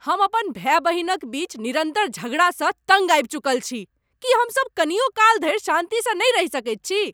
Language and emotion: Maithili, angry